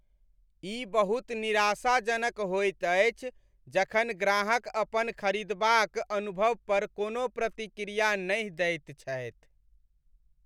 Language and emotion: Maithili, sad